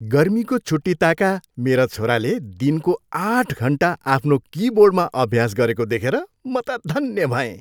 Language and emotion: Nepali, happy